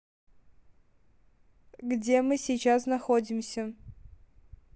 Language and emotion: Russian, neutral